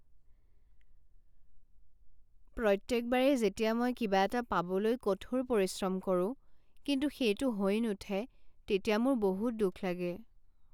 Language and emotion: Assamese, sad